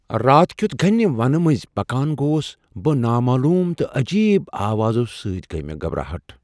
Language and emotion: Kashmiri, fearful